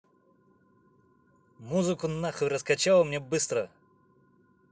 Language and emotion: Russian, angry